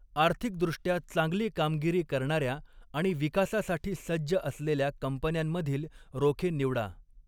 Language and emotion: Marathi, neutral